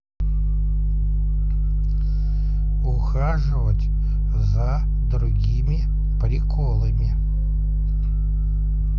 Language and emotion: Russian, neutral